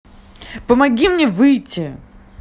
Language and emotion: Russian, angry